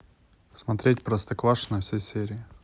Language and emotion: Russian, neutral